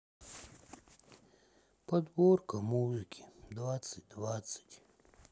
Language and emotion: Russian, sad